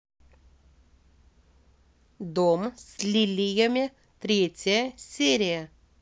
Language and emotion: Russian, neutral